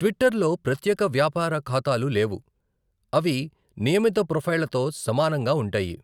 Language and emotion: Telugu, neutral